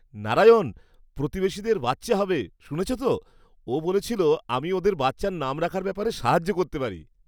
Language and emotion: Bengali, happy